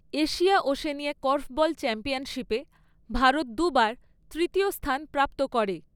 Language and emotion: Bengali, neutral